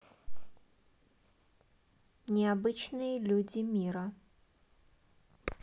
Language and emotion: Russian, neutral